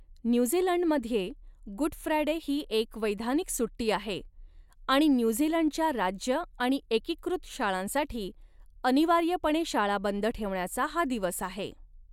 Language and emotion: Marathi, neutral